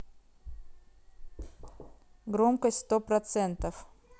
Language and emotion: Russian, neutral